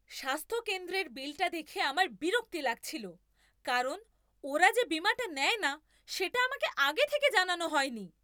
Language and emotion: Bengali, angry